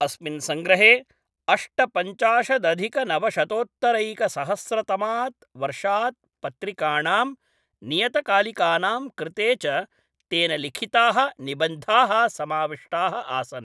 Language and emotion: Sanskrit, neutral